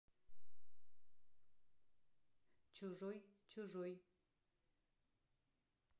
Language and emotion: Russian, neutral